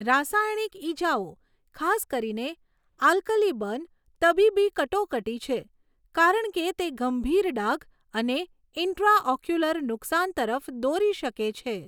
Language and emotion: Gujarati, neutral